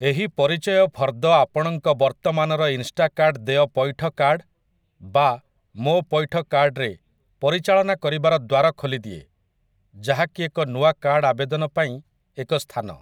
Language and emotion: Odia, neutral